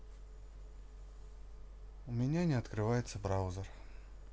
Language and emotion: Russian, sad